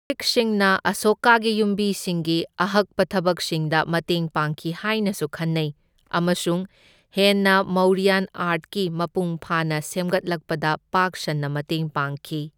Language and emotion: Manipuri, neutral